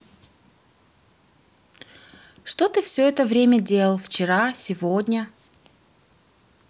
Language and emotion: Russian, neutral